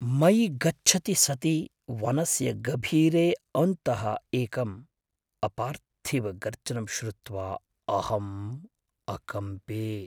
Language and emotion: Sanskrit, fearful